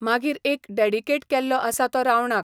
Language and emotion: Goan Konkani, neutral